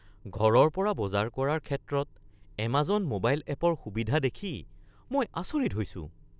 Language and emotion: Assamese, surprised